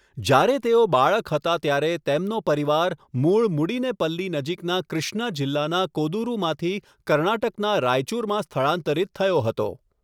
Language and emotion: Gujarati, neutral